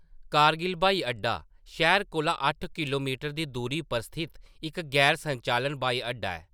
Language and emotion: Dogri, neutral